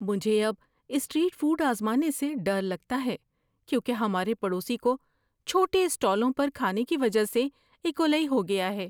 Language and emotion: Urdu, fearful